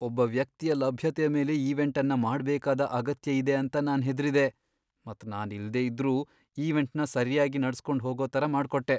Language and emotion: Kannada, fearful